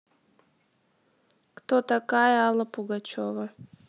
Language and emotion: Russian, neutral